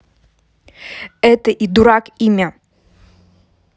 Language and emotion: Russian, angry